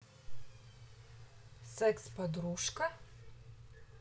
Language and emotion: Russian, neutral